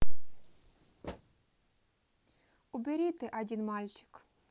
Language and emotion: Russian, neutral